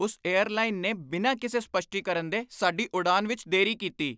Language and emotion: Punjabi, angry